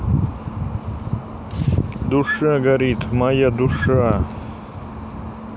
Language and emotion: Russian, neutral